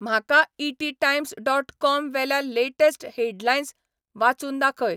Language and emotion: Goan Konkani, neutral